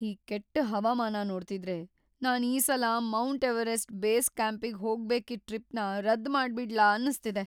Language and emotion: Kannada, fearful